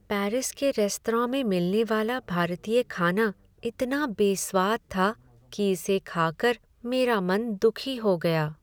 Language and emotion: Hindi, sad